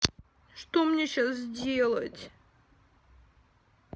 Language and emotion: Russian, sad